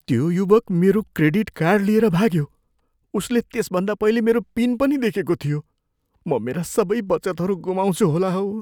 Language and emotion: Nepali, fearful